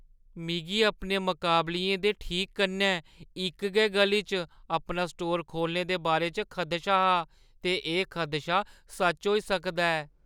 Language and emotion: Dogri, fearful